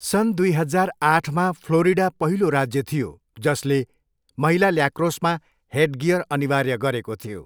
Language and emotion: Nepali, neutral